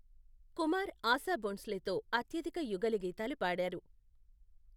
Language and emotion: Telugu, neutral